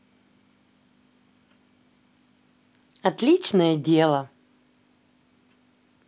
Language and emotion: Russian, positive